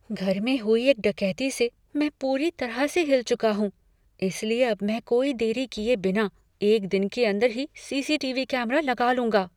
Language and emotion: Hindi, fearful